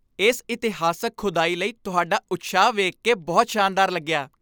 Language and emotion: Punjabi, happy